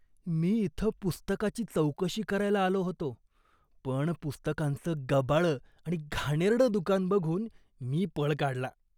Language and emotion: Marathi, disgusted